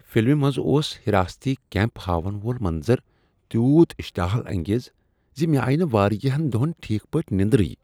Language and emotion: Kashmiri, disgusted